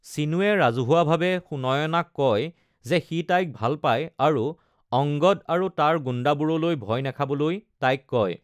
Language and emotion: Assamese, neutral